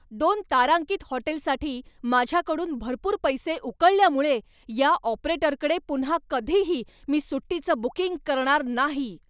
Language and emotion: Marathi, angry